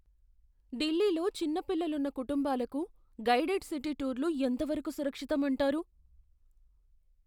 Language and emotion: Telugu, fearful